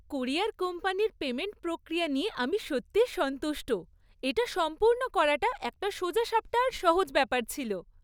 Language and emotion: Bengali, happy